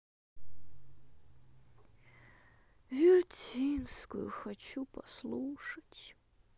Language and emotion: Russian, sad